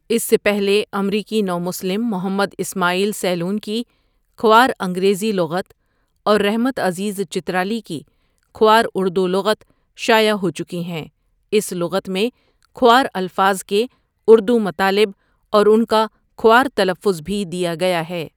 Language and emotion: Urdu, neutral